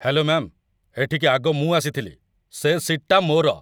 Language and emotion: Odia, angry